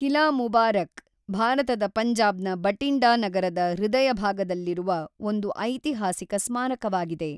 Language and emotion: Kannada, neutral